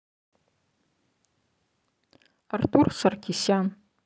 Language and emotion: Russian, neutral